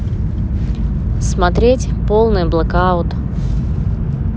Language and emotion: Russian, neutral